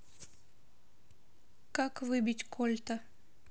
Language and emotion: Russian, neutral